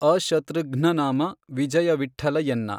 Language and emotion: Kannada, neutral